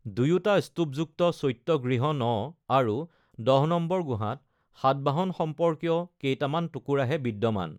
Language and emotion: Assamese, neutral